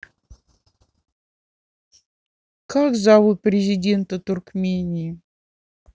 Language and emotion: Russian, neutral